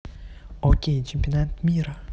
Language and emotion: Russian, neutral